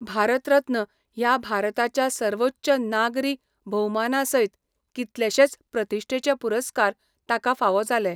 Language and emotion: Goan Konkani, neutral